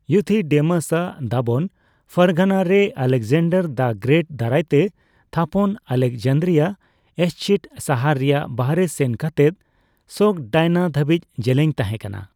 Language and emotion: Santali, neutral